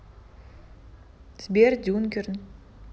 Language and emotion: Russian, neutral